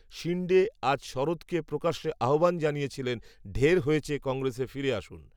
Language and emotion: Bengali, neutral